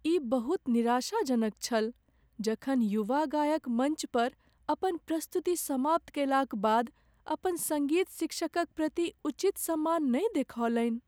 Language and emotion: Maithili, sad